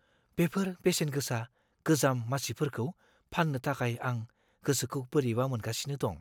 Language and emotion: Bodo, fearful